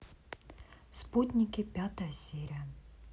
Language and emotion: Russian, neutral